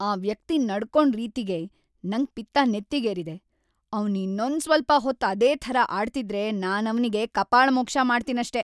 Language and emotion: Kannada, angry